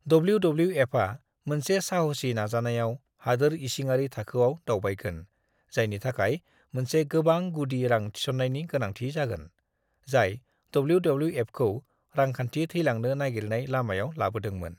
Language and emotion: Bodo, neutral